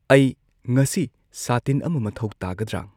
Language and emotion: Manipuri, neutral